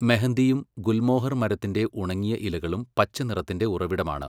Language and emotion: Malayalam, neutral